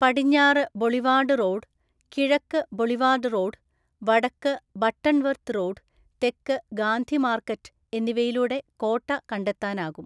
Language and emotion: Malayalam, neutral